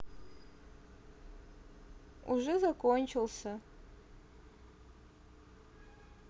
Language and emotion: Russian, sad